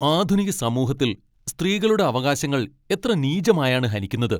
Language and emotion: Malayalam, angry